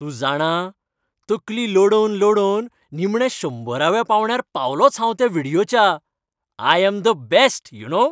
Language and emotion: Goan Konkani, happy